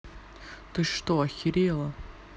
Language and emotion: Russian, angry